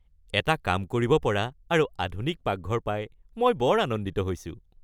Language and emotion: Assamese, happy